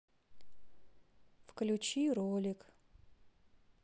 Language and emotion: Russian, sad